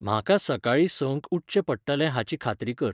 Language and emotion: Goan Konkani, neutral